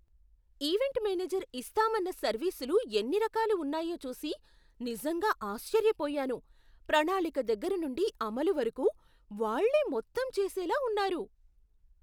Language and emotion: Telugu, surprised